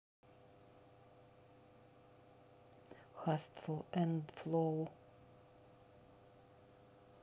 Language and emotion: Russian, neutral